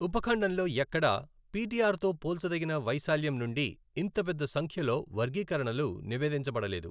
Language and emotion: Telugu, neutral